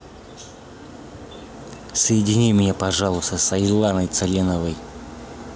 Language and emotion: Russian, neutral